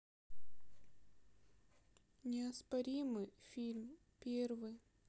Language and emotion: Russian, sad